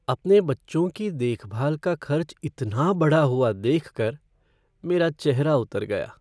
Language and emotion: Hindi, sad